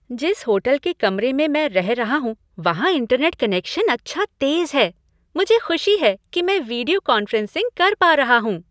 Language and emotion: Hindi, happy